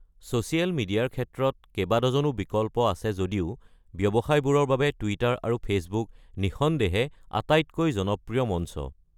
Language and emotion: Assamese, neutral